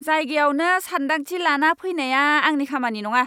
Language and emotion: Bodo, angry